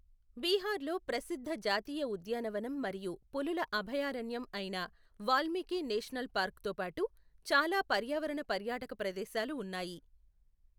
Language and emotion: Telugu, neutral